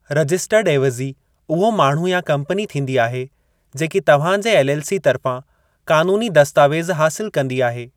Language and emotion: Sindhi, neutral